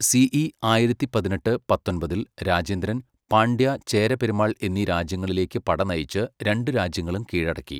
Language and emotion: Malayalam, neutral